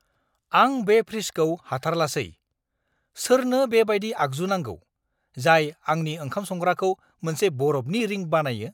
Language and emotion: Bodo, angry